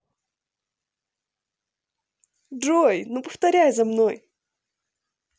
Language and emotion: Russian, positive